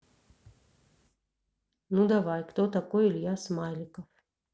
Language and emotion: Russian, neutral